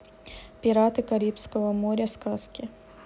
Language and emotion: Russian, neutral